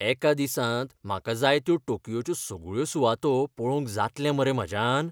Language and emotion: Goan Konkani, fearful